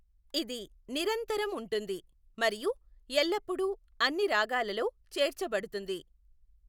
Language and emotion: Telugu, neutral